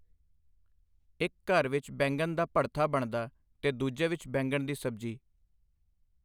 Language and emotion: Punjabi, neutral